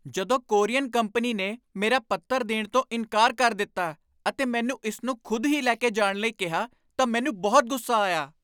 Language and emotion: Punjabi, angry